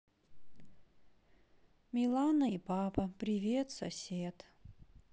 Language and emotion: Russian, sad